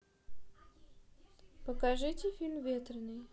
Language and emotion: Russian, neutral